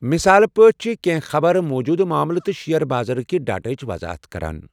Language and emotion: Kashmiri, neutral